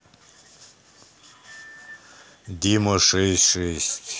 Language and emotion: Russian, neutral